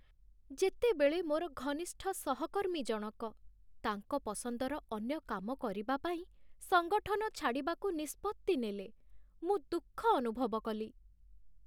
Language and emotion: Odia, sad